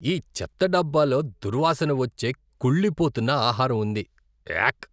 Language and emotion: Telugu, disgusted